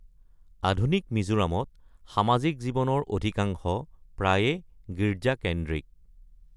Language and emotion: Assamese, neutral